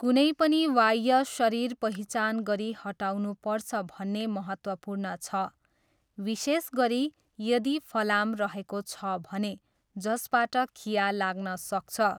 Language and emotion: Nepali, neutral